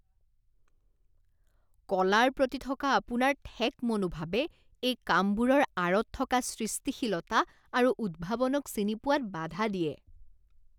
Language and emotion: Assamese, disgusted